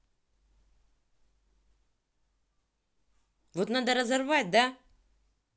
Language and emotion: Russian, angry